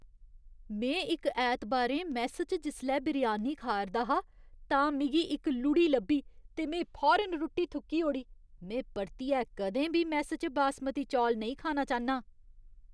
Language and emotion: Dogri, disgusted